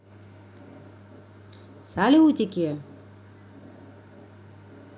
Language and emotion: Russian, neutral